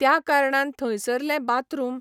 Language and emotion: Goan Konkani, neutral